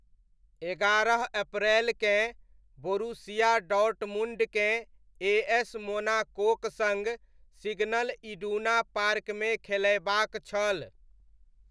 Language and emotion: Maithili, neutral